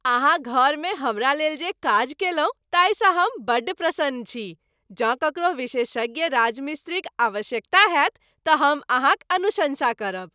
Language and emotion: Maithili, happy